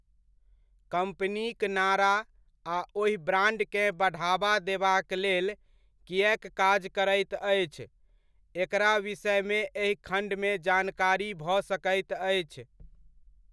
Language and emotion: Maithili, neutral